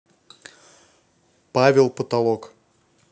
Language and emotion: Russian, neutral